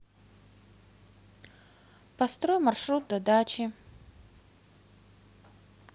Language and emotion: Russian, neutral